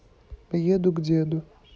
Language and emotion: Russian, neutral